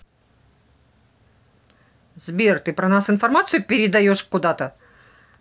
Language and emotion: Russian, angry